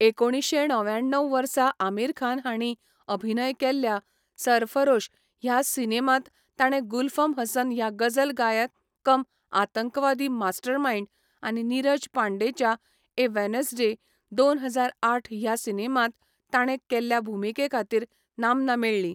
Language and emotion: Goan Konkani, neutral